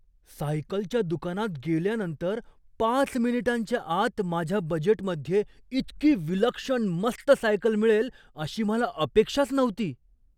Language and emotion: Marathi, surprised